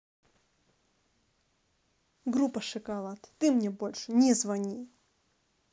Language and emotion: Russian, angry